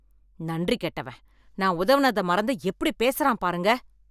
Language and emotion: Tamil, angry